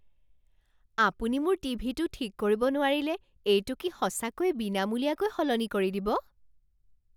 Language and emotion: Assamese, surprised